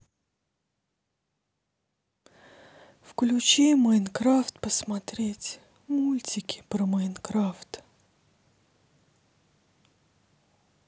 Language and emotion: Russian, sad